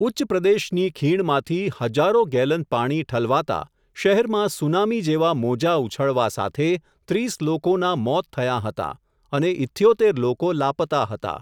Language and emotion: Gujarati, neutral